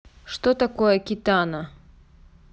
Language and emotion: Russian, neutral